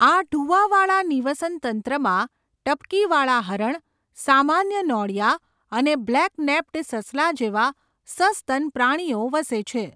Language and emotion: Gujarati, neutral